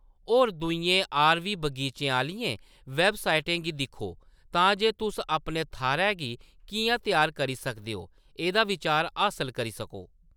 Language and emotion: Dogri, neutral